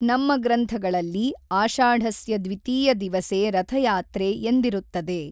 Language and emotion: Kannada, neutral